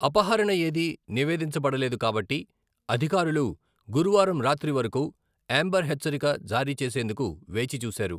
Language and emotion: Telugu, neutral